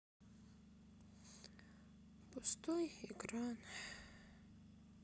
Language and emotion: Russian, sad